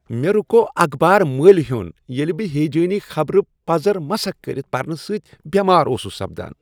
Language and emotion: Kashmiri, disgusted